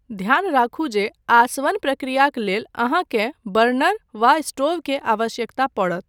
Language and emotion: Maithili, neutral